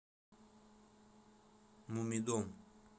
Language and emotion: Russian, neutral